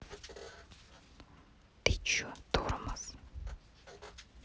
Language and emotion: Russian, neutral